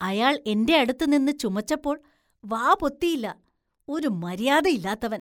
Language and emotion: Malayalam, disgusted